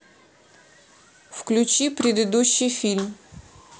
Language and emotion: Russian, neutral